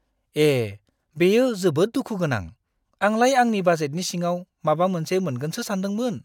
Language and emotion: Bodo, disgusted